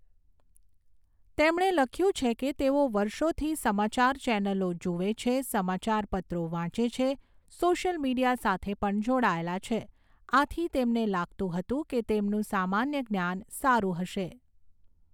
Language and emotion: Gujarati, neutral